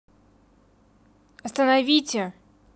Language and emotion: Russian, angry